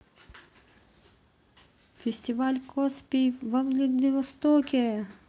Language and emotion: Russian, positive